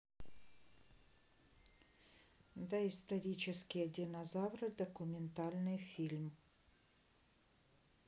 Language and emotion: Russian, neutral